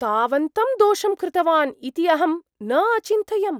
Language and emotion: Sanskrit, surprised